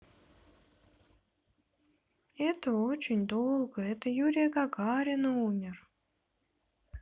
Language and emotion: Russian, sad